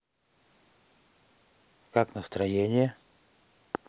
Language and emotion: Russian, neutral